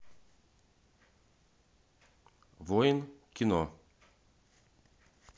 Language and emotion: Russian, neutral